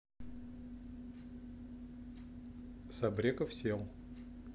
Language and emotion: Russian, neutral